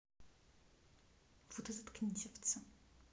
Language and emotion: Russian, angry